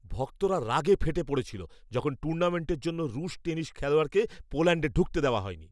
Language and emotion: Bengali, angry